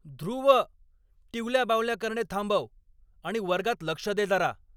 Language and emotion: Marathi, angry